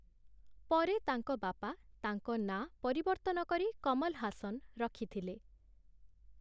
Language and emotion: Odia, neutral